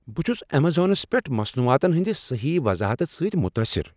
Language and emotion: Kashmiri, surprised